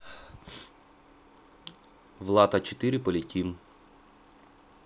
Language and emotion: Russian, neutral